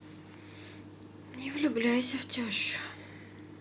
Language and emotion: Russian, sad